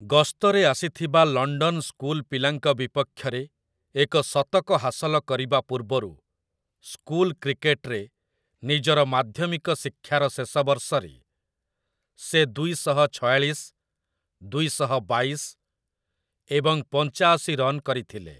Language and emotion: Odia, neutral